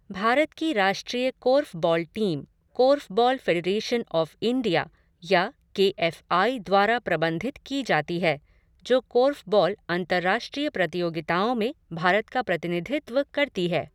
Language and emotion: Hindi, neutral